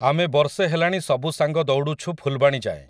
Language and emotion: Odia, neutral